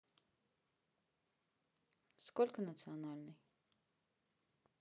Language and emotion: Russian, neutral